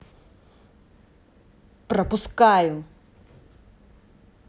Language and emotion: Russian, angry